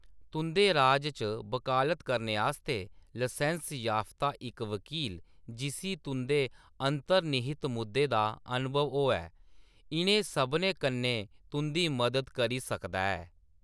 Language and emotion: Dogri, neutral